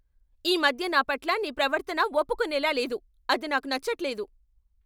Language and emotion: Telugu, angry